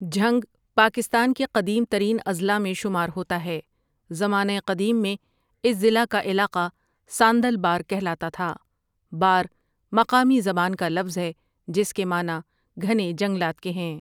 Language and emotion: Urdu, neutral